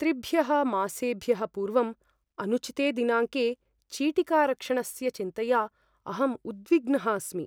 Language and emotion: Sanskrit, fearful